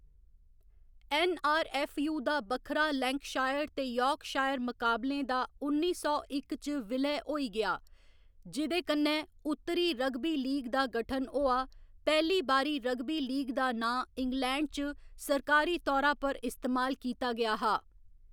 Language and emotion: Dogri, neutral